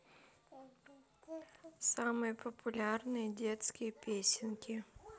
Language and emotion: Russian, neutral